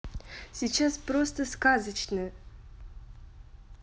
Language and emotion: Russian, positive